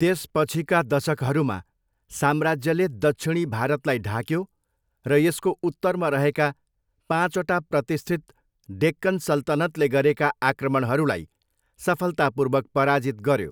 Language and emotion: Nepali, neutral